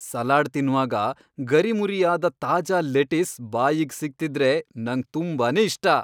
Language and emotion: Kannada, happy